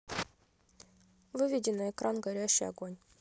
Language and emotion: Russian, neutral